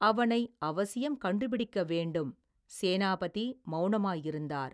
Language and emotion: Tamil, neutral